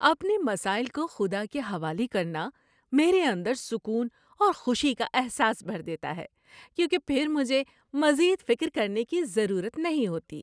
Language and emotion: Urdu, happy